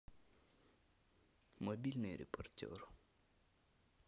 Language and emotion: Russian, neutral